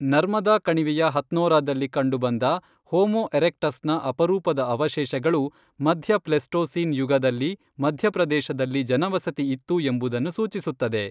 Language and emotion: Kannada, neutral